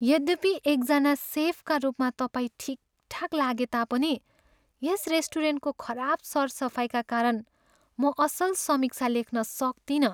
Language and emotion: Nepali, sad